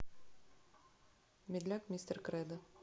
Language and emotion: Russian, neutral